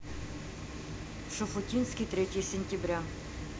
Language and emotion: Russian, neutral